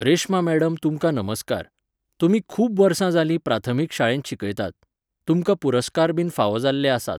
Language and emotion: Goan Konkani, neutral